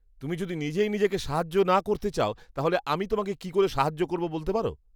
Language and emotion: Bengali, disgusted